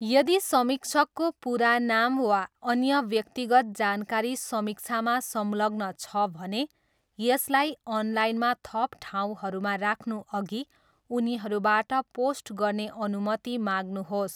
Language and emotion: Nepali, neutral